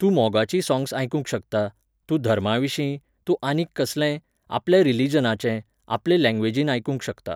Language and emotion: Goan Konkani, neutral